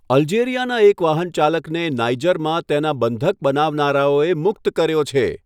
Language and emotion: Gujarati, neutral